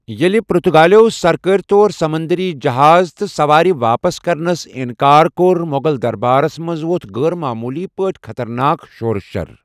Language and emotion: Kashmiri, neutral